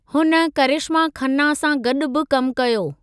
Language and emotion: Sindhi, neutral